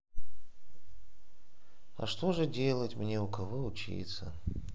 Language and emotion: Russian, sad